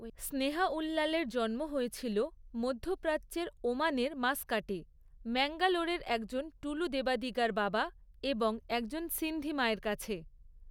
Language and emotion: Bengali, neutral